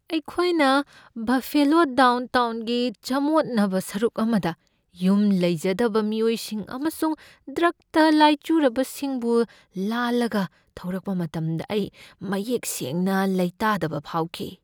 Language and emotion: Manipuri, fearful